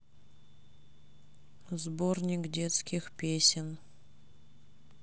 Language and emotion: Russian, sad